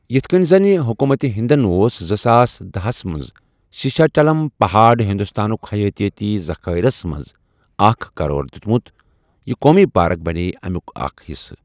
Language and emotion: Kashmiri, neutral